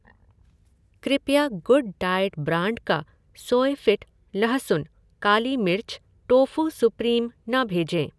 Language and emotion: Hindi, neutral